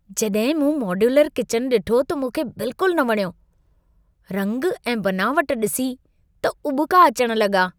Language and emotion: Sindhi, disgusted